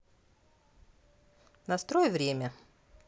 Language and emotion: Russian, neutral